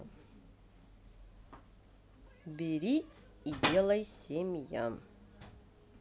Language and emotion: Russian, neutral